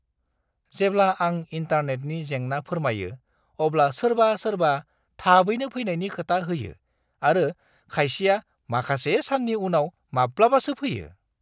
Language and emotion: Bodo, disgusted